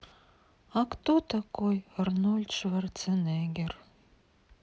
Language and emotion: Russian, sad